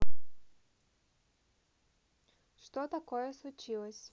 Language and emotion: Russian, neutral